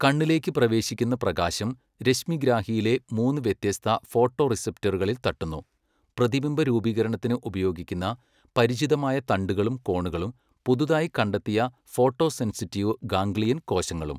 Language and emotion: Malayalam, neutral